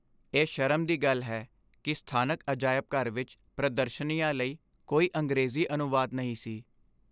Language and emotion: Punjabi, sad